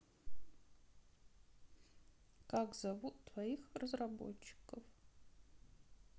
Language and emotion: Russian, sad